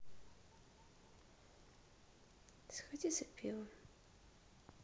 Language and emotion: Russian, sad